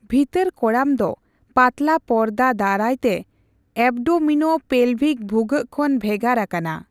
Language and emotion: Santali, neutral